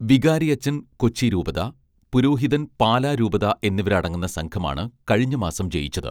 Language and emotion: Malayalam, neutral